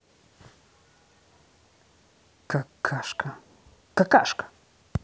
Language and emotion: Russian, angry